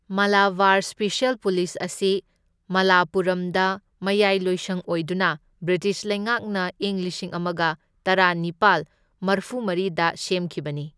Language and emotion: Manipuri, neutral